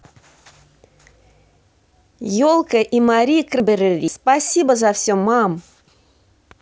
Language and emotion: Russian, positive